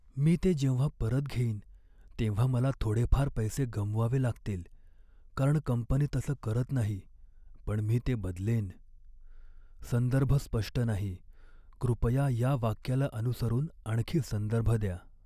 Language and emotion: Marathi, sad